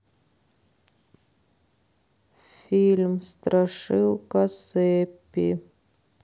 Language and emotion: Russian, sad